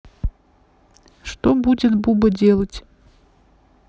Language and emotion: Russian, neutral